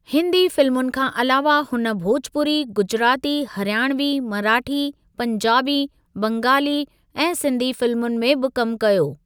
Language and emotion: Sindhi, neutral